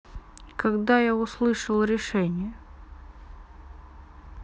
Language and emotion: Russian, neutral